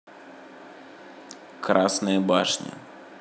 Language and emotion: Russian, neutral